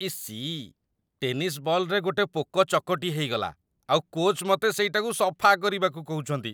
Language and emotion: Odia, disgusted